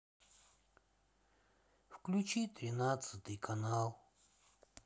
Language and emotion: Russian, sad